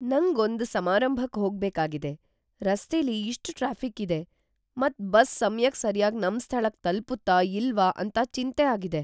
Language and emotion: Kannada, fearful